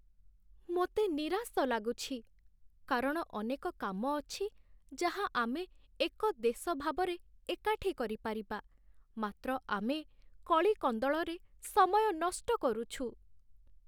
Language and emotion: Odia, sad